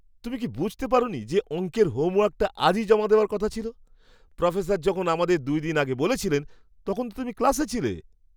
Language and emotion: Bengali, surprised